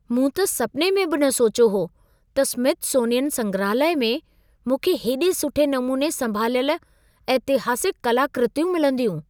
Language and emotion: Sindhi, surprised